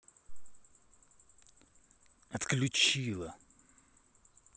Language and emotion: Russian, angry